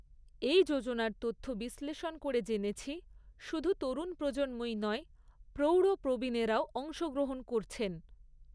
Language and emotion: Bengali, neutral